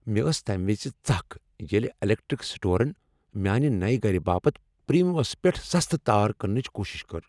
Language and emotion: Kashmiri, angry